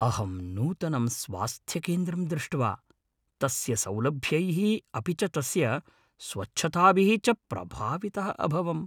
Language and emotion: Sanskrit, happy